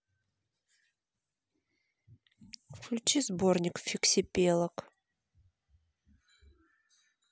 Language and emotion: Russian, neutral